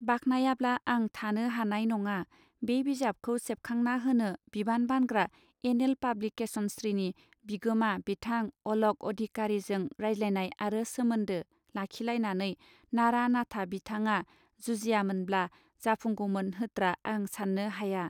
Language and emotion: Bodo, neutral